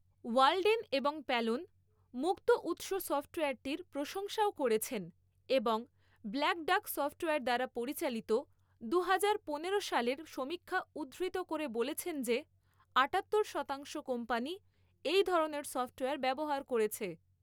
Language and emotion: Bengali, neutral